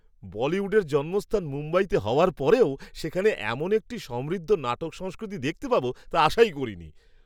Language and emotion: Bengali, surprised